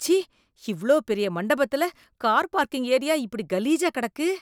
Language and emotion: Tamil, disgusted